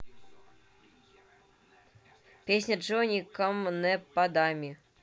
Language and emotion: Russian, neutral